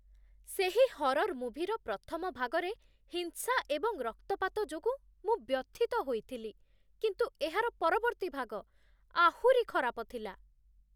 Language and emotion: Odia, disgusted